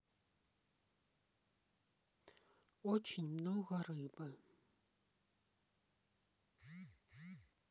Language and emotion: Russian, sad